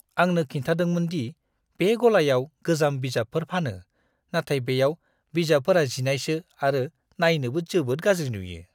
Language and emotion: Bodo, disgusted